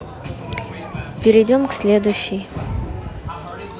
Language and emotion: Russian, neutral